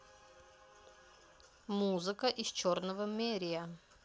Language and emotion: Russian, neutral